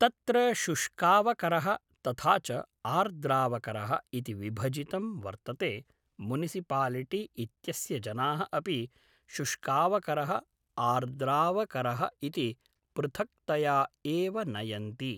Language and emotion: Sanskrit, neutral